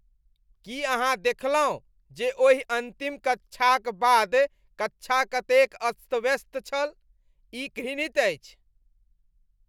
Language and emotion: Maithili, disgusted